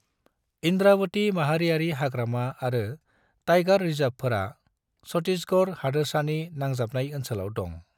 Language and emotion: Bodo, neutral